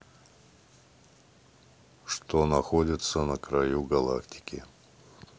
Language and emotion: Russian, neutral